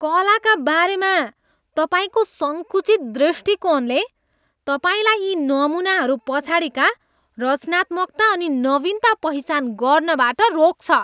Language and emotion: Nepali, disgusted